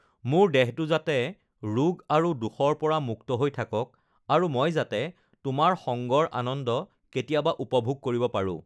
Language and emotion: Assamese, neutral